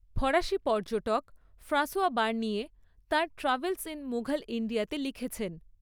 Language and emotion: Bengali, neutral